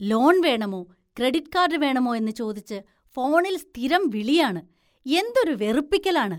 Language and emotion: Malayalam, disgusted